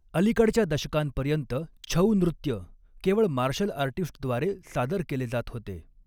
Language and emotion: Marathi, neutral